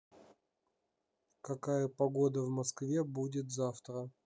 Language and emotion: Russian, neutral